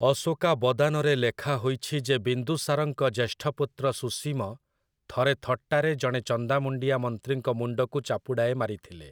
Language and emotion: Odia, neutral